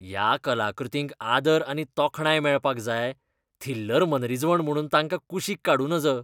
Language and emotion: Goan Konkani, disgusted